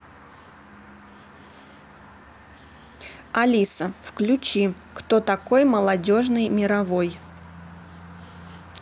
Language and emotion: Russian, neutral